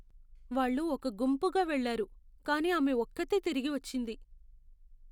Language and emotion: Telugu, sad